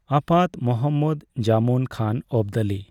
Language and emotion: Santali, neutral